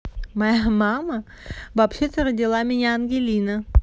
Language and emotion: Russian, positive